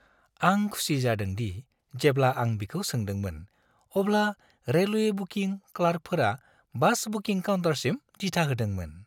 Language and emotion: Bodo, happy